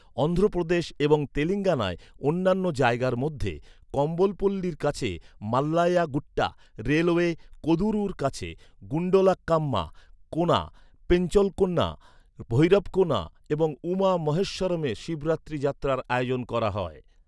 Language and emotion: Bengali, neutral